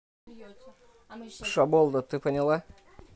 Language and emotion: Russian, neutral